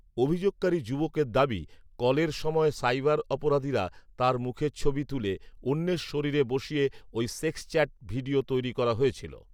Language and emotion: Bengali, neutral